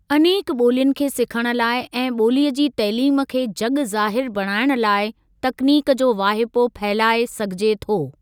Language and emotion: Sindhi, neutral